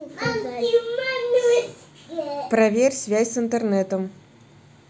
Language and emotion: Russian, neutral